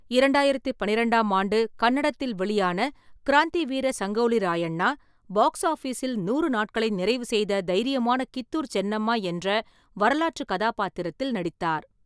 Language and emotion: Tamil, neutral